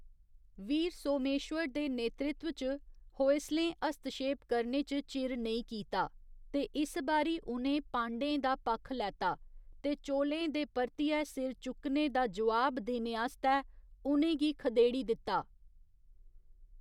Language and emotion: Dogri, neutral